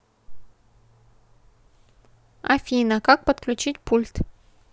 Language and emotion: Russian, neutral